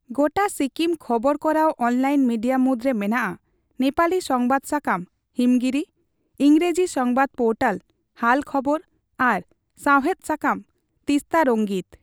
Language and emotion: Santali, neutral